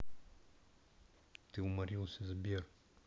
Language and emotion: Russian, neutral